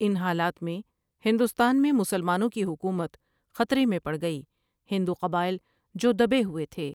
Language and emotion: Urdu, neutral